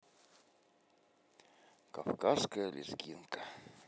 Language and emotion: Russian, neutral